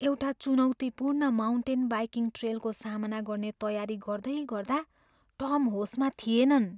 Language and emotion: Nepali, fearful